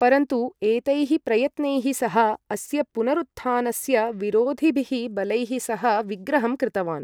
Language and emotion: Sanskrit, neutral